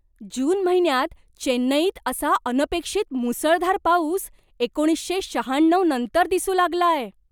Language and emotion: Marathi, surprised